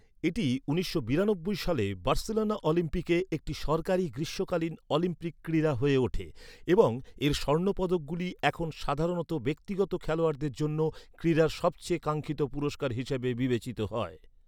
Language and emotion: Bengali, neutral